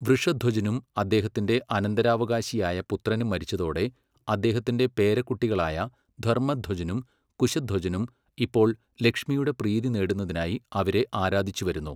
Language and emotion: Malayalam, neutral